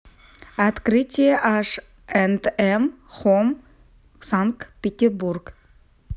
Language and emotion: Russian, neutral